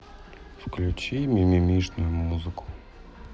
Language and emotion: Russian, sad